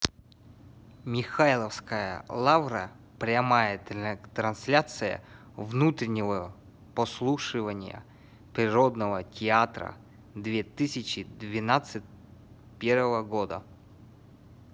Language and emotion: Russian, neutral